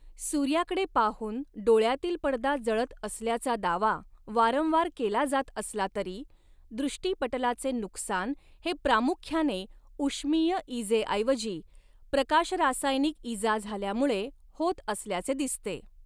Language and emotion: Marathi, neutral